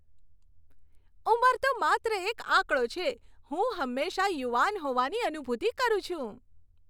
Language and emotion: Gujarati, happy